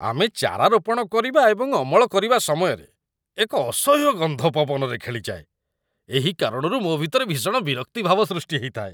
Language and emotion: Odia, disgusted